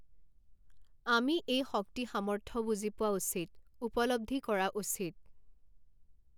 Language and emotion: Assamese, neutral